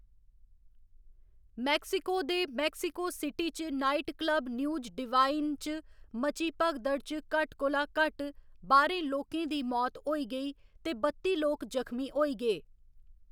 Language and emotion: Dogri, neutral